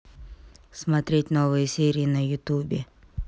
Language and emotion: Russian, neutral